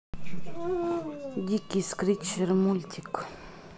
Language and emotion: Russian, neutral